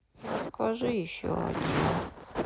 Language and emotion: Russian, sad